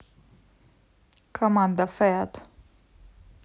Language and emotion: Russian, neutral